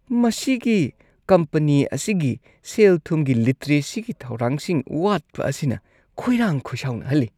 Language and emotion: Manipuri, disgusted